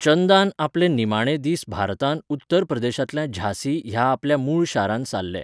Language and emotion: Goan Konkani, neutral